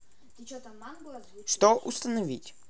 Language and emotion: Russian, neutral